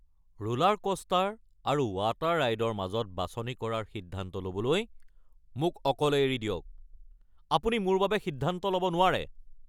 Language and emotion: Assamese, angry